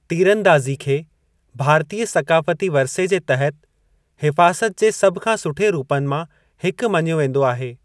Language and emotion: Sindhi, neutral